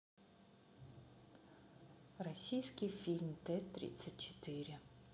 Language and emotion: Russian, neutral